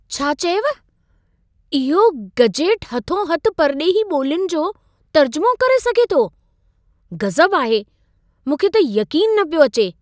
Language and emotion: Sindhi, surprised